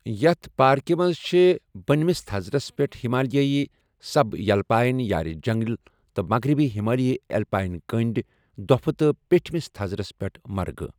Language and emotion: Kashmiri, neutral